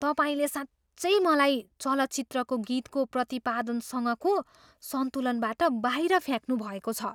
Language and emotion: Nepali, surprised